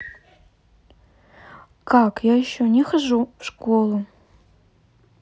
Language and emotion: Russian, neutral